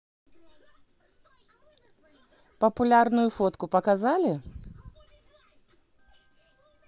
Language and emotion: Russian, positive